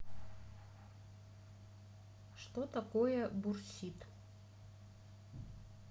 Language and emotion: Russian, neutral